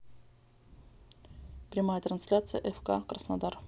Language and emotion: Russian, neutral